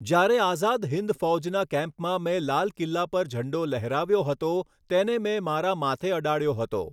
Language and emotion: Gujarati, neutral